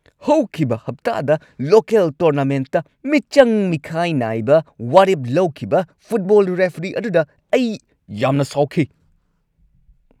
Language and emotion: Manipuri, angry